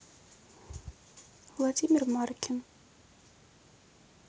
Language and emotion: Russian, neutral